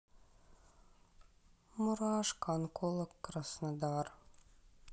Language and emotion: Russian, sad